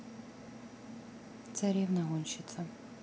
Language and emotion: Russian, neutral